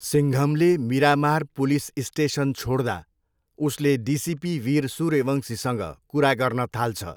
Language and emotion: Nepali, neutral